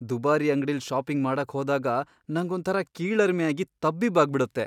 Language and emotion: Kannada, fearful